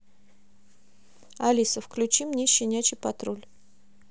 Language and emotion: Russian, neutral